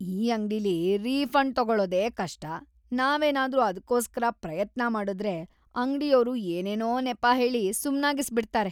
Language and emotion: Kannada, disgusted